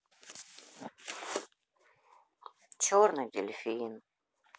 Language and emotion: Russian, sad